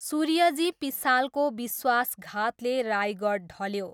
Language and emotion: Nepali, neutral